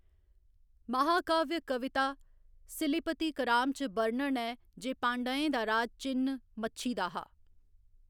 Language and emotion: Dogri, neutral